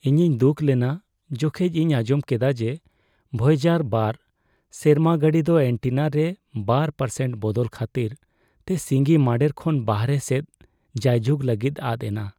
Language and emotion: Santali, sad